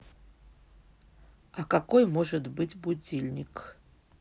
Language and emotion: Russian, neutral